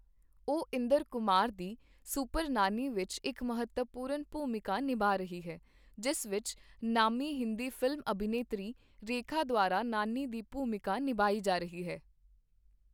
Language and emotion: Punjabi, neutral